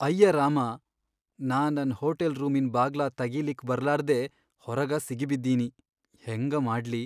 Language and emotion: Kannada, sad